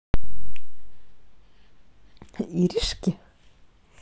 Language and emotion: Russian, positive